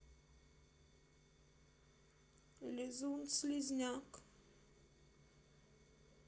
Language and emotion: Russian, sad